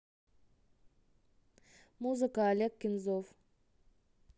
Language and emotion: Russian, neutral